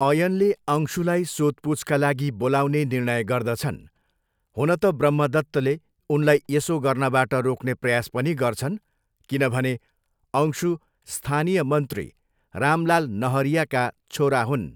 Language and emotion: Nepali, neutral